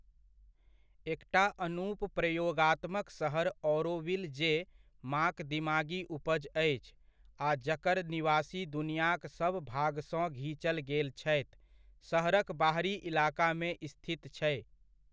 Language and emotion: Maithili, neutral